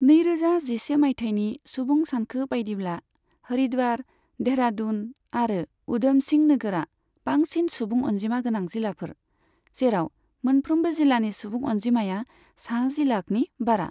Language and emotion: Bodo, neutral